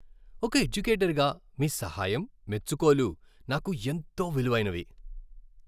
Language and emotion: Telugu, happy